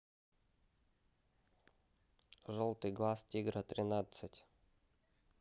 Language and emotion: Russian, neutral